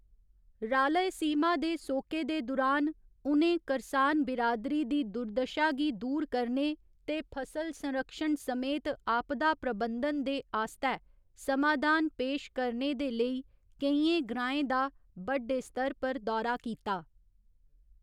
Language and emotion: Dogri, neutral